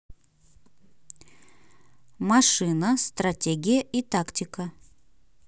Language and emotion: Russian, neutral